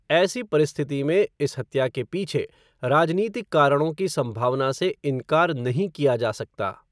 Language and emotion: Hindi, neutral